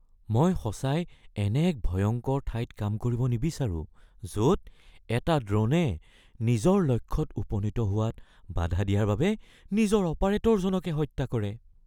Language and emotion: Assamese, fearful